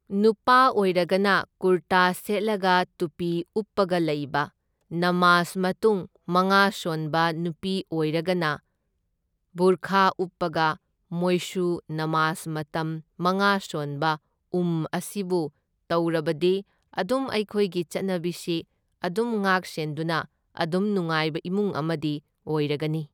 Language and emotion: Manipuri, neutral